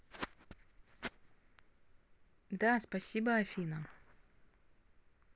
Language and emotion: Russian, neutral